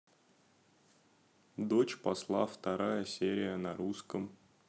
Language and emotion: Russian, neutral